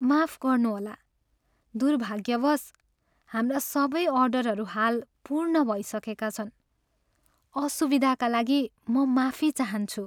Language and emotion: Nepali, sad